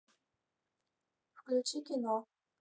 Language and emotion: Russian, neutral